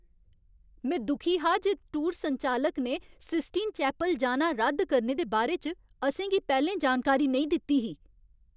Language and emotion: Dogri, angry